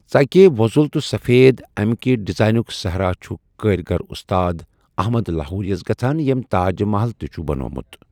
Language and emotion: Kashmiri, neutral